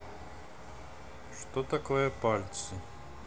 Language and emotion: Russian, neutral